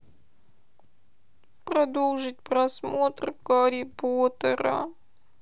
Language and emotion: Russian, sad